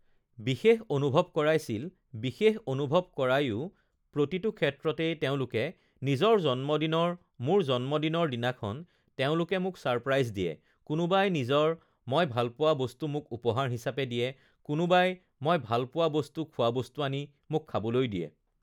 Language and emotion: Assamese, neutral